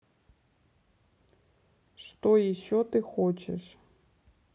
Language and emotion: Russian, neutral